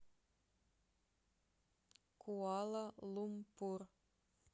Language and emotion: Russian, neutral